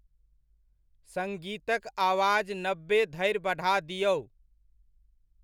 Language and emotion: Maithili, neutral